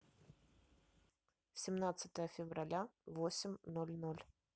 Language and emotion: Russian, neutral